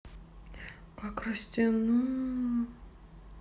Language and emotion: Russian, sad